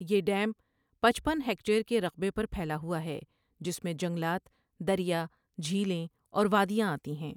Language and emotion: Urdu, neutral